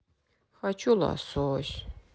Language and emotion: Russian, sad